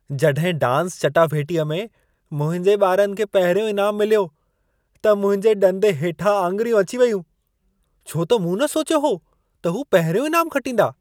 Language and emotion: Sindhi, surprised